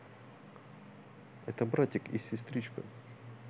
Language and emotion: Russian, neutral